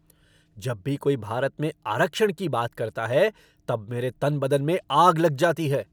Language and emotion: Hindi, angry